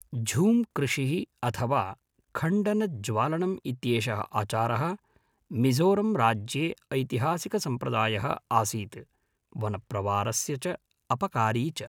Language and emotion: Sanskrit, neutral